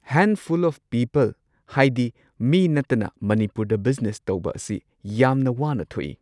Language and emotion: Manipuri, neutral